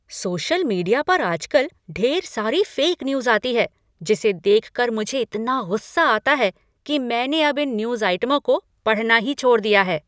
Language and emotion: Hindi, angry